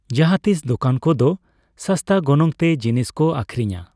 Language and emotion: Santali, neutral